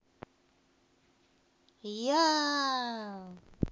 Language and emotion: Russian, positive